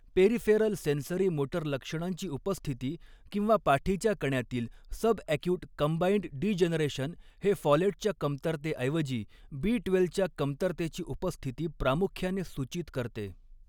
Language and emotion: Marathi, neutral